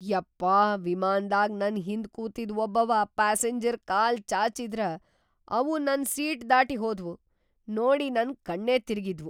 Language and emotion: Kannada, surprised